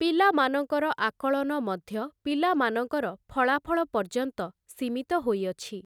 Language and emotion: Odia, neutral